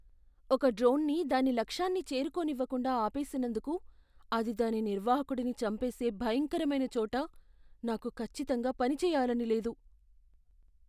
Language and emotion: Telugu, fearful